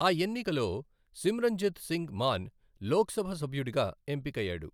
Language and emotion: Telugu, neutral